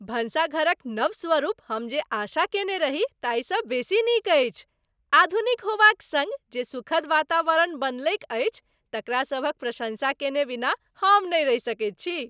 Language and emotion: Maithili, happy